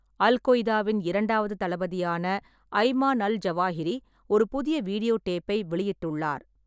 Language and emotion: Tamil, neutral